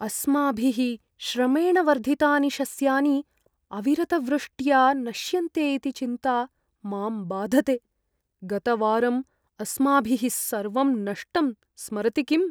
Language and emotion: Sanskrit, fearful